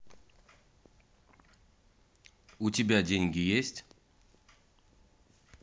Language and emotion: Russian, neutral